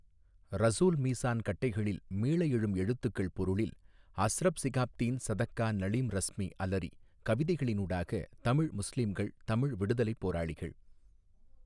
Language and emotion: Tamil, neutral